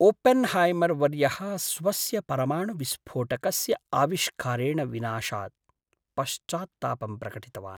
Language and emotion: Sanskrit, sad